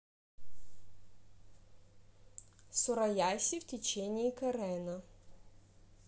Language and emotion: Russian, neutral